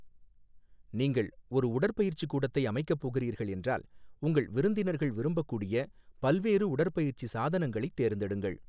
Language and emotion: Tamil, neutral